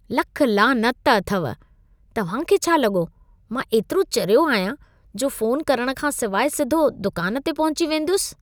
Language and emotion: Sindhi, disgusted